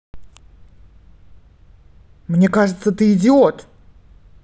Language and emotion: Russian, angry